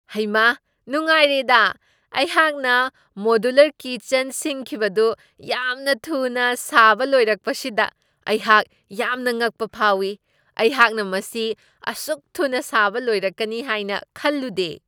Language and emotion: Manipuri, surprised